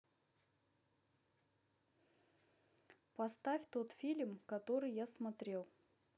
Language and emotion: Russian, neutral